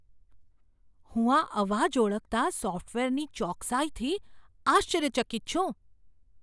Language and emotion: Gujarati, surprised